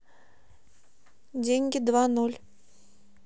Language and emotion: Russian, neutral